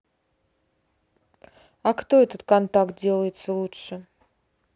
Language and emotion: Russian, neutral